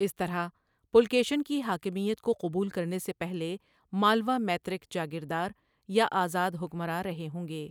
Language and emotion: Urdu, neutral